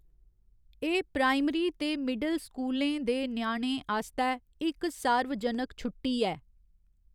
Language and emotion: Dogri, neutral